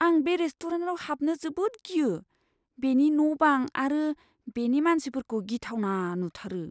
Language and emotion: Bodo, fearful